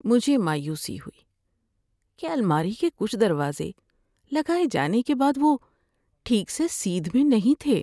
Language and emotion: Urdu, sad